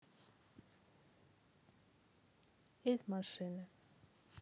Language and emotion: Russian, neutral